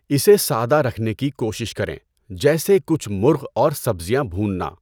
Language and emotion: Urdu, neutral